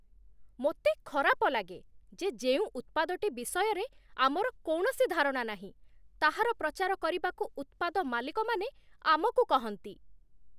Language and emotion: Odia, disgusted